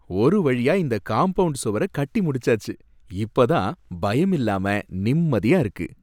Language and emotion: Tamil, happy